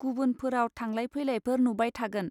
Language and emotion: Bodo, neutral